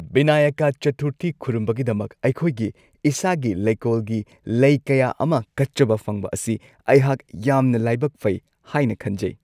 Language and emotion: Manipuri, happy